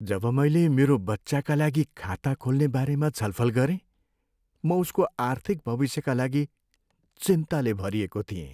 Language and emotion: Nepali, sad